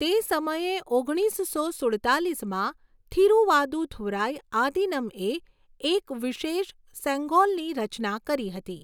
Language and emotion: Gujarati, neutral